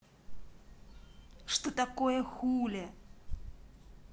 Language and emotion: Russian, angry